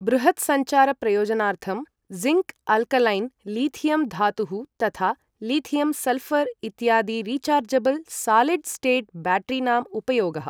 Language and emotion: Sanskrit, neutral